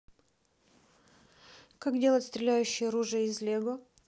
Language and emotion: Russian, neutral